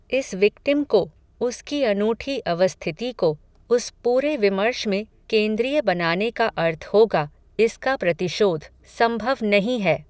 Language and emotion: Hindi, neutral